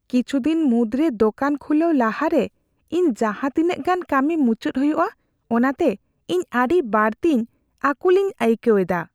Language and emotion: Santali, fearful